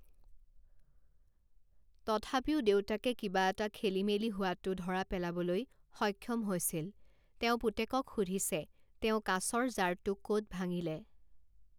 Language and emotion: Assamese, neutral